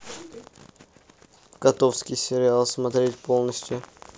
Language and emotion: Russian, neutral